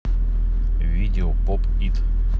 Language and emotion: Russian, neutral